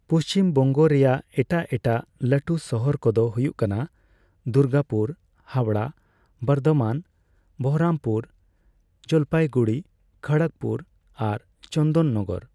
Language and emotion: Santali, neutral